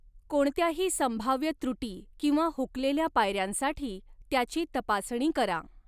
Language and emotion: Marathi, neutral